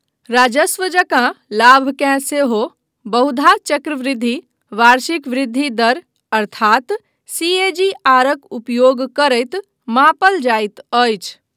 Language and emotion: Maithili, neutral